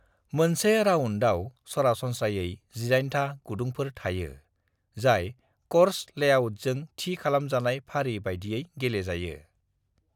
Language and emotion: Bodo, neutral